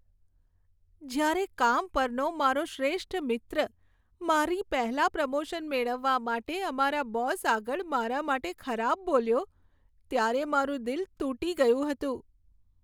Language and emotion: Gujarati, sad